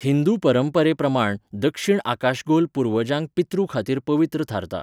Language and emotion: Goan Konkani, neutral